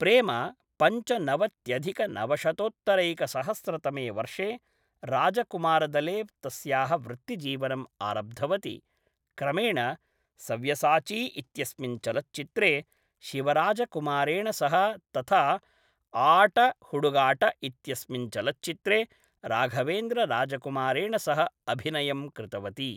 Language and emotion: Sanskrit, neutral